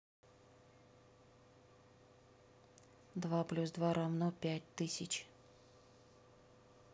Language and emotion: Russian, neutral